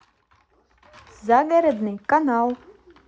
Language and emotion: Russian, positive